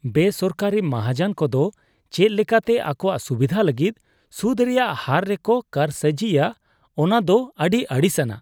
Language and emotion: Santali, disgusted